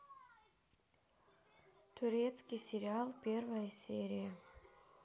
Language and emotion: Russian, neutral